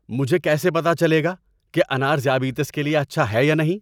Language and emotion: Urdu, angry